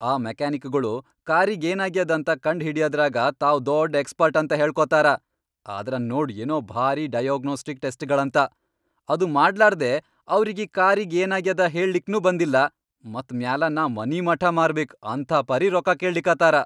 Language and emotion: Kannada, angry